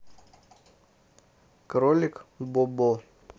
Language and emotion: Russian, neutral